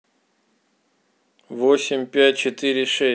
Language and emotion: Russian, neutral